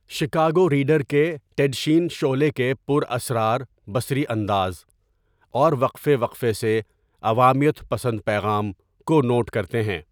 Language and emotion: Urdu, neutral